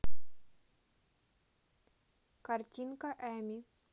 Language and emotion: Russian, neutral